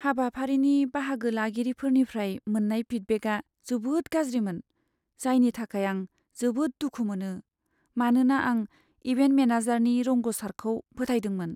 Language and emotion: Bodo, sad